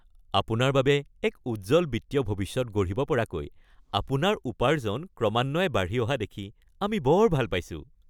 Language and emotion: Assamese, happy